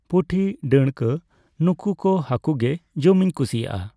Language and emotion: Santali, neutral